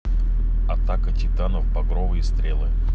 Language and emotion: Russian, neutral